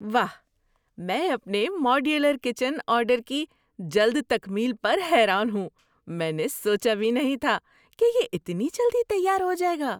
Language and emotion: Urdu, surprised